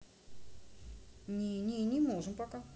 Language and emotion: Russian, neutral